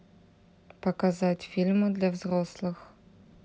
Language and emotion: Russian, neutral